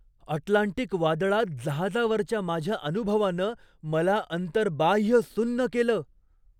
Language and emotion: Marathi, surprised